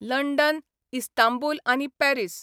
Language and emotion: Goan Konkani, neutral